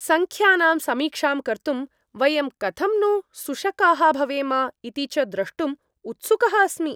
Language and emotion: Sanskrit, happy